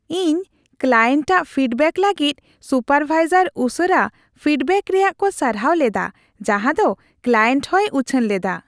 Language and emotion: Santali, happy